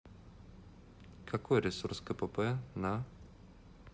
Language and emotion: Russian, neutral